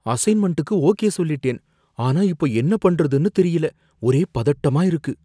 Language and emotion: Tamil, fearful